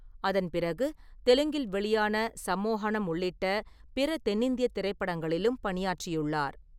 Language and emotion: Tamil, neutral